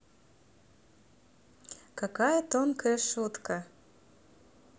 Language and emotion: Russian, neutral